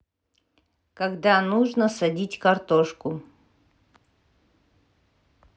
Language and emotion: Russian, neutral